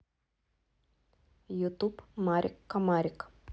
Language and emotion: Russian, neutral